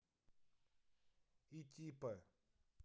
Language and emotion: Russian, neutral